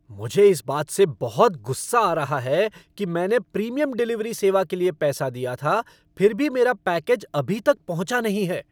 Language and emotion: Hindi, angry